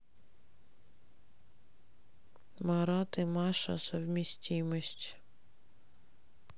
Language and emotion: Russian, neutral